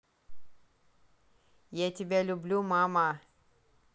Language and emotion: Russian, positive